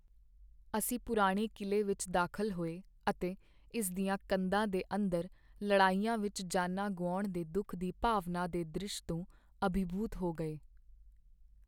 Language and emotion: Punjabi, sad